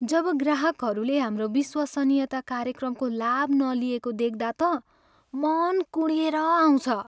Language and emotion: Nepali, sad